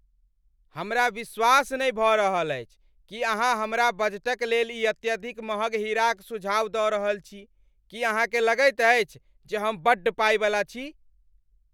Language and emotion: Maithili, angry